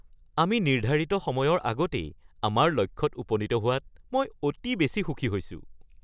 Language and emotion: Assamese, happy